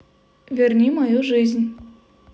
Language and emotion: Russian, neutral